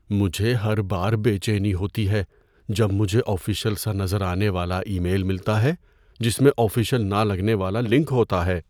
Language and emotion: Urdu, fearful